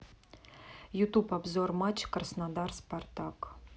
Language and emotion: Russian, neutral